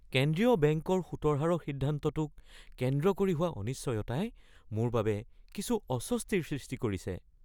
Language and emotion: Assamese, fearful